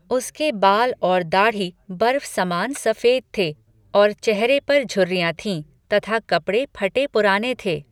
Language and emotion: Hindi, neutral